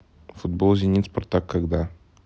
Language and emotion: Russian, neutral